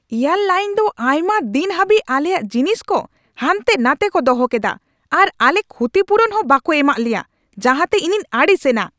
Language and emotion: Santali, angry